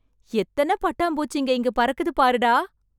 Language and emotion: Tamil, surprised